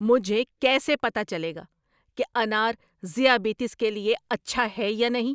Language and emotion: Urdu, angry